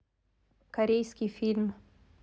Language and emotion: Russian, neutral